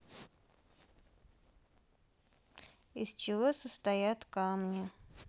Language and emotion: Russian, neutral